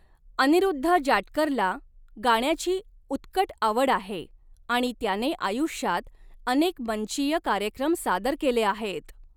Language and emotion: Marathi, neutral